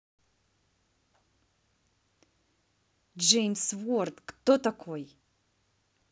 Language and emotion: Russian, angry